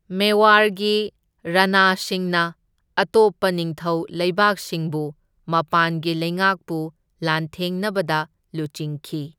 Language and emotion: Manipuri, neutral